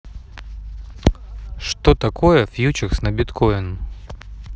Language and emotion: Russian, neutral